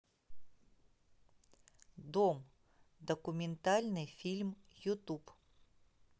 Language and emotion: Russian, neutral